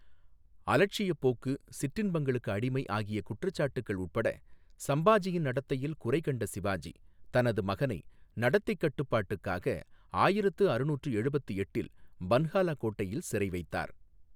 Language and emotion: Tamil, neutral